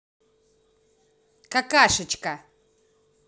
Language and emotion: Russian, angry